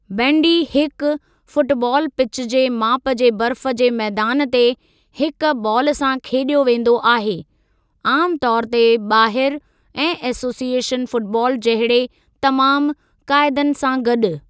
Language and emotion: Sindhi, neutral